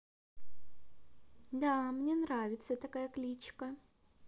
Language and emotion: Russian, neutral